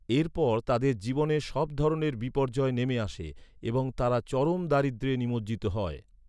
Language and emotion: Bengali, neutral